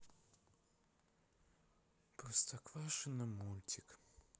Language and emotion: Russian, sad